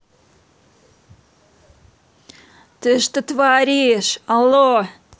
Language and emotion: Russian, angry